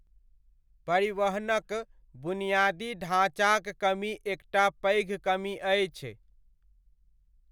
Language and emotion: Maithili, neutral